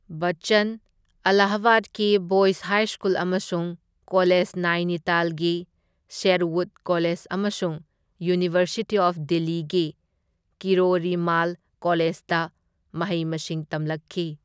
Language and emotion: Manipuri, neutral